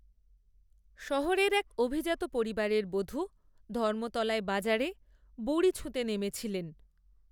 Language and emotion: Bengali, neutral